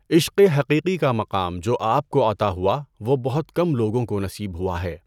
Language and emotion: Urdu, neutral